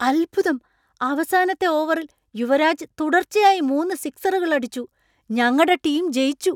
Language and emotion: Malayalam, surprised